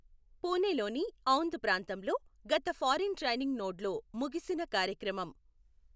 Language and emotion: Telugu, neutral